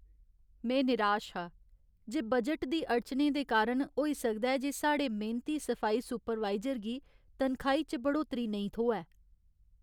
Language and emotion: Dogri, sad